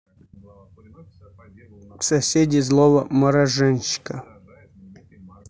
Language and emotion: Russian, neutral